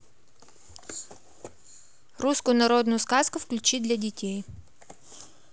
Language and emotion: Russian, neutral